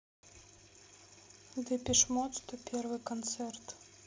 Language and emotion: Russian, sad